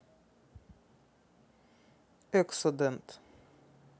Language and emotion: Russian, neutral